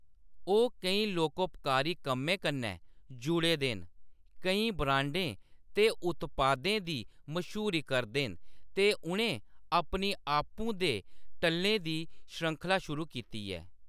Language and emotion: Dogri, neutral